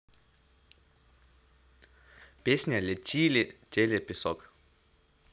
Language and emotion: Russian, positive